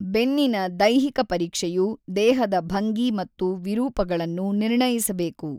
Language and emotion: Kannada, neutral